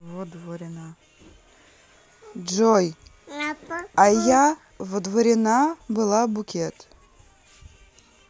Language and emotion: Russian, neutral